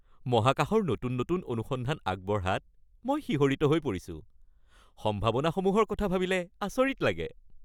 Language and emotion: Assamese, happy